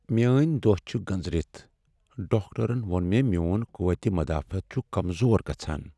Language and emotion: Kashmiri, sad